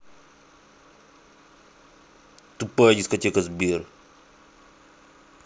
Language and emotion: Russian, angry